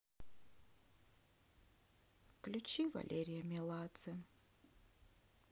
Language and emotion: Russian, sad